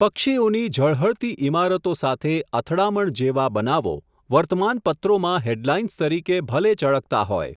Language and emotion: Gujarati, neutral